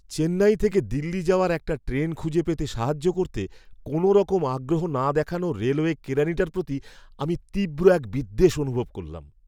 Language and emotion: Bengali, disgusted